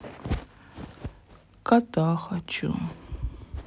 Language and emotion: Russian, sad